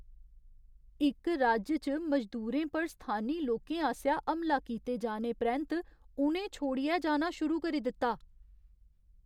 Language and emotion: Dogri, fearful